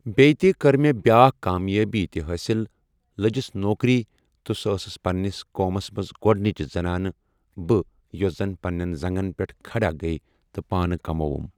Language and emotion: Kashmiri, neutral